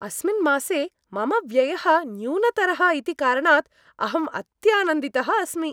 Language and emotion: Sanskrit, happy